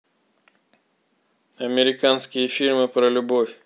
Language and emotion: Russian, neutral